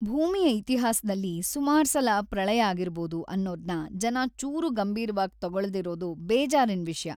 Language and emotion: Kannada, sad